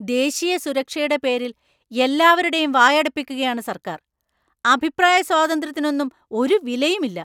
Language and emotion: Malayalam, angry